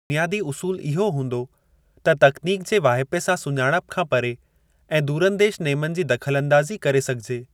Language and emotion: Sindhi, neutral